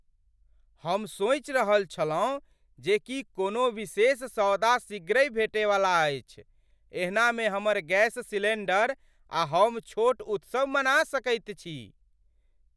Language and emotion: Maithili, surprised